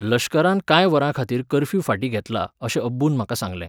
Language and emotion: Goan Konkani, neutral